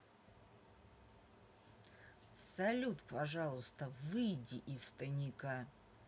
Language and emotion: Russian, neutral